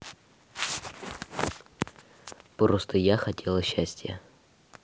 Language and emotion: Russian, neutral